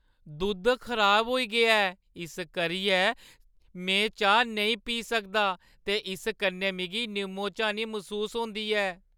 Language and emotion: Dogri, sad